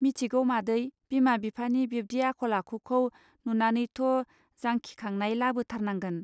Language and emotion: Bodo, neutral